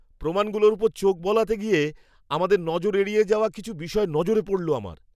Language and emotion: Bengali, surprised